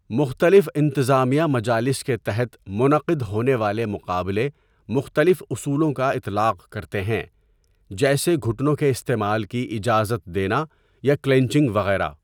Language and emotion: Urdu, neutral